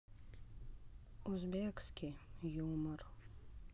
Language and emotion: Russian, sad